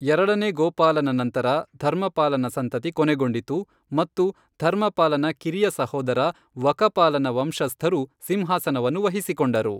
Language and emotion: Kannada, neutral